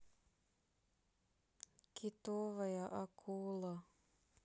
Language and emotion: Russian, sad